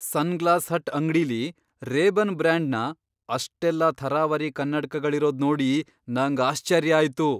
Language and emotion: Kannada, surprised